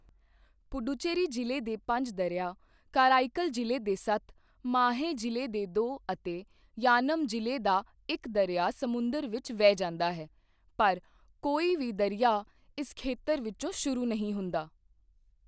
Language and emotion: Punjabi, neutral